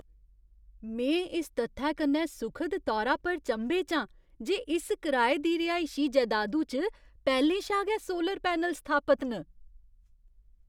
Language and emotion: Dogri, surprised